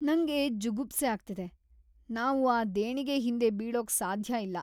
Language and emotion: Kannada, disgusted